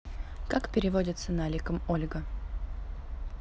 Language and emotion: Russian, neutral